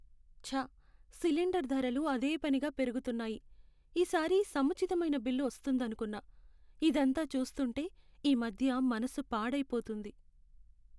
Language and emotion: Telugu, sad